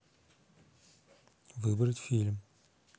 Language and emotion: Russian, neutral